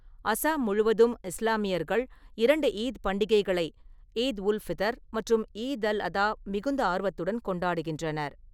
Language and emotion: Tamil, neutral